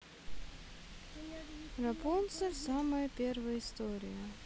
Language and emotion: Russian, neutral